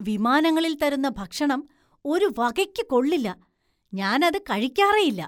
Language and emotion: Malayalam, disgusted